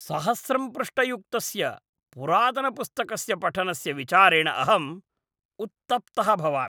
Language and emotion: Sanskrit, disgusted